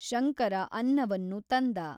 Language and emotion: Kannada, neutral